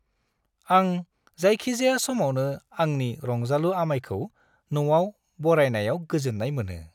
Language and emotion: Bodo, happy